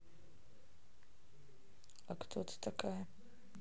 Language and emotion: Russian, neutral